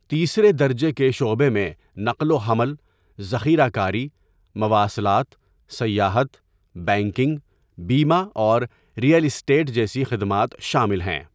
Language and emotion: Urdu, neutral